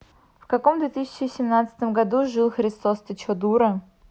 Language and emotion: Russian, angry